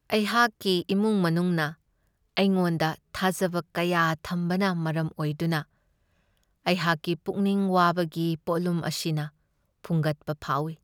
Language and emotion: Manipuri, sad